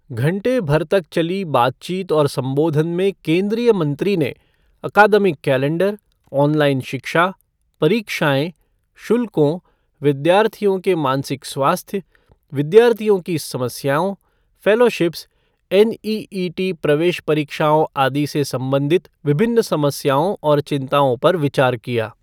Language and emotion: Hindi, neutral